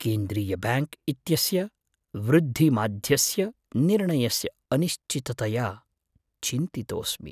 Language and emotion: Sanskrit, fearful